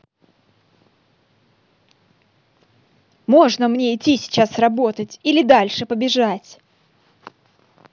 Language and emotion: Russian, angry